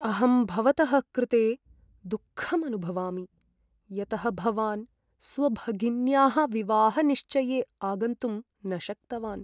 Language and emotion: Sanskrit, sad